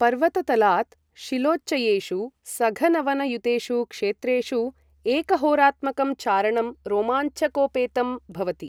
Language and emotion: Sanskrit, neutral